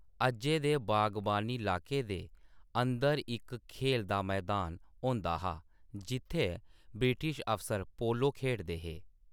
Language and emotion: Dogri, neutral